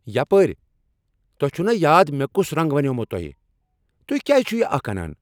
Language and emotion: Kashmiri, angry